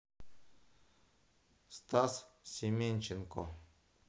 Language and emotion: Russian, neutral